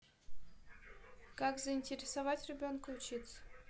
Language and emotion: Russian, neutral